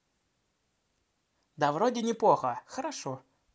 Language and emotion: Russian, positive